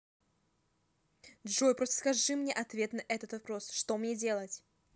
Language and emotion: Russian, neutral